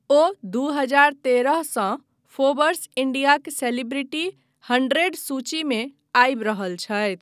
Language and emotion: Maithili, neutral